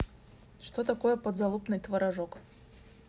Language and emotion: Russian, neutral